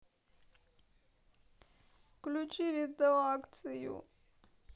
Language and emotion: Russian, sad